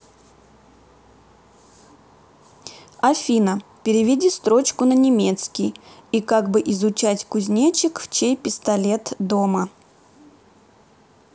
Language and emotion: Russian, neutral